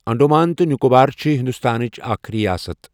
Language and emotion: Kashmiri, neutral